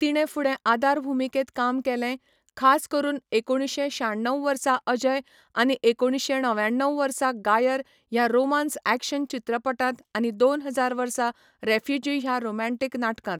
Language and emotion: Goan Konkani, neutral